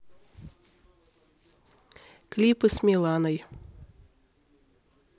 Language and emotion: Russian, neutral